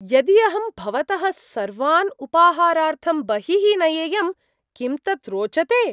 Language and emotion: Sanskrit, surprised